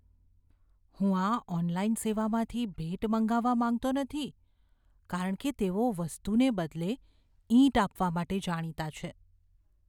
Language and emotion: Gujarati, fearful